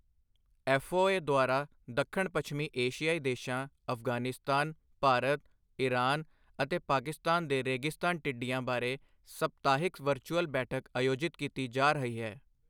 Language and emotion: Punjabi, neutral